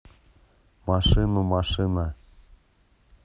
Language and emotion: Russian, neutral